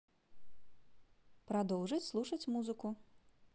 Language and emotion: Russian, positive